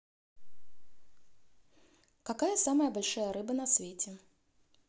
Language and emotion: Russian, neutral